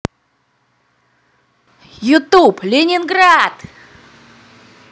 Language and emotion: Russian, positive